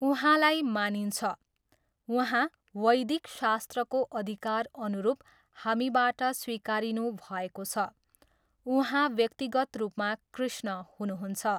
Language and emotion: Nepali, neutral